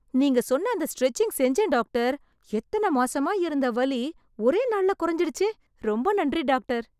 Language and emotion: Tamil, surprised